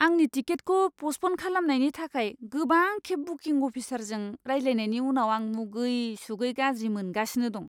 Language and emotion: Bodo, disgusted